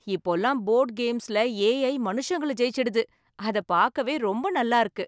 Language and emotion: Tamil, happy